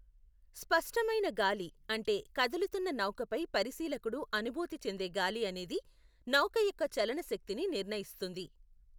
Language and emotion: Telugu, neutral